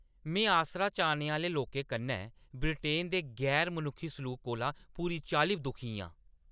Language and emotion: Dogri, angry